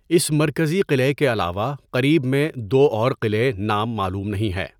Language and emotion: Urdu, neutral